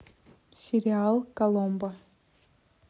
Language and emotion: Russian, neutral